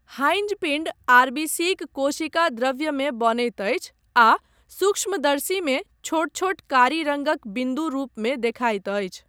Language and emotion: Maithili, neutral